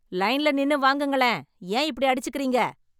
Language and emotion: Tamil, angry